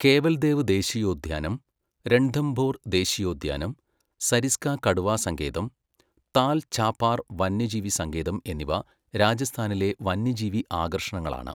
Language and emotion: Malayalam, neutral